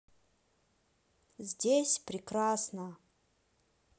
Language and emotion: Russian, neutral